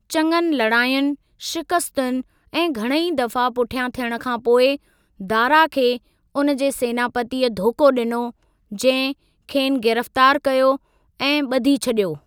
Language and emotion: Sindhi, neutral